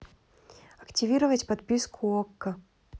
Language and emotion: Russian, neutral